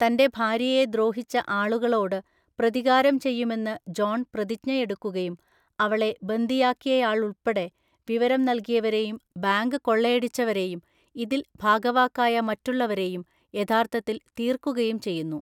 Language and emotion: Malayalam, neutral